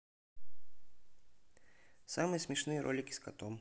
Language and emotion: Russian, neutral